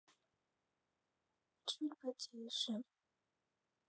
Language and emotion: Russian, sad